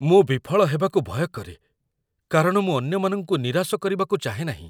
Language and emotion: Odia, fearful